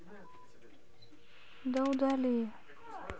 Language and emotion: Russian, neutral